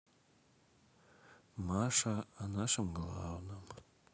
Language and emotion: Russian, sad